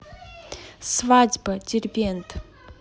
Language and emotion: Russian, neutral